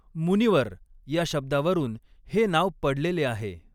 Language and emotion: Marathi, neutral